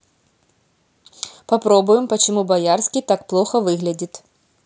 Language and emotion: Russian, neutral